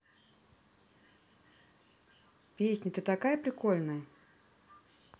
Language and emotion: Russian, positive